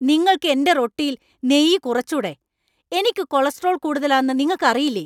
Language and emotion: Malayalam, angry